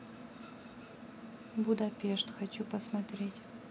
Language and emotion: Russian, neutral